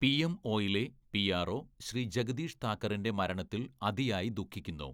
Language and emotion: Malayalam, neutral